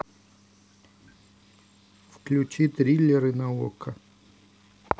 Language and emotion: Russian, neutral